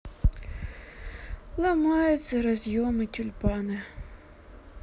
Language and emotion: Russian, sad